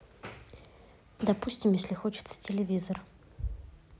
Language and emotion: Russian, neutral